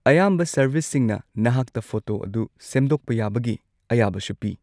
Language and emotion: Manipuri, neutral